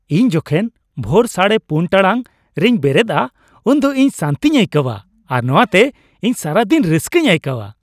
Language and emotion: Santali, happy